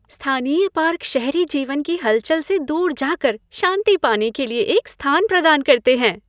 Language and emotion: Hindi, happy